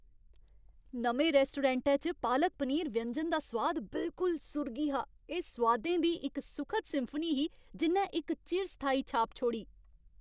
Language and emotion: Dogri, happy